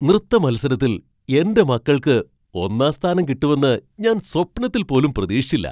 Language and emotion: Malayalam, surprised